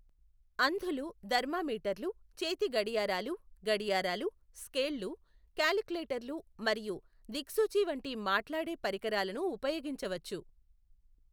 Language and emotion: Telugu, neutral